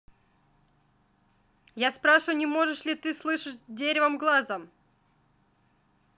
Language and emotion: Russian, angry